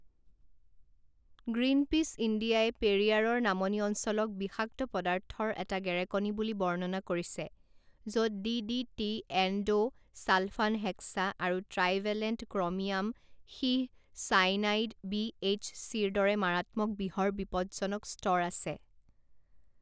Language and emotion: Assamese, neutral